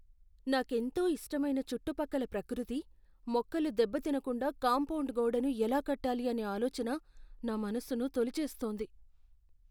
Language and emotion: Telugu, fearful